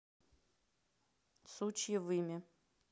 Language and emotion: Russian, neutral